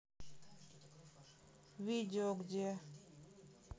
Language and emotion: Russian, neutral